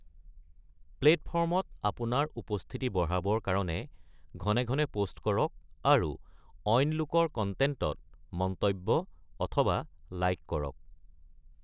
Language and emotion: Assamese, neutral